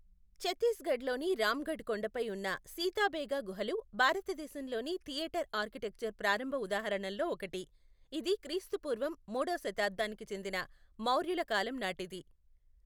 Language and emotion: Telugu, neutral